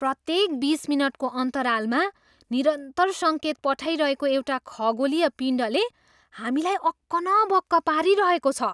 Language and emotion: Nepali, surprised